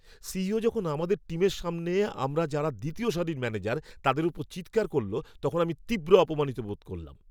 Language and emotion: Bengali, angry